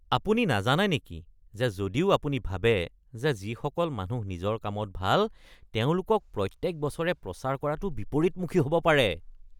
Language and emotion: Assamese, disgusted